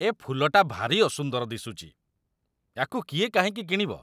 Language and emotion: Odia, disgusted